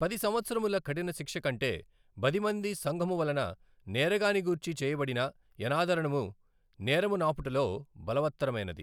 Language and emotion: Telugu, neutral